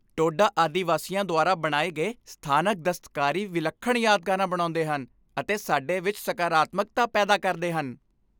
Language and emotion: Punjabi, happy